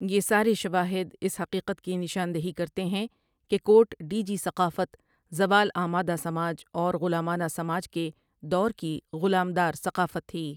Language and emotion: Urdu, neutral